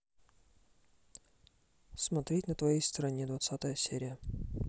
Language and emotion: Russian, neutral